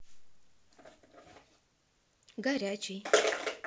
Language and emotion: Russian, neutral